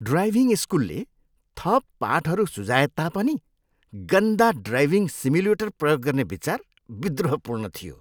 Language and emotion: Nepali, disgusted